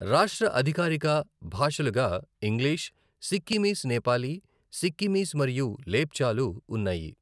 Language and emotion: Telugu, neutral